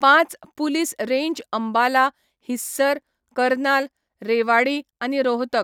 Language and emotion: Goan Konkani, neutral